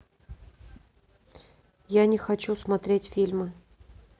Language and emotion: Russian, neutral